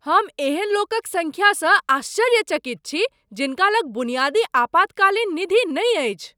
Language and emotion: Maithili, surprised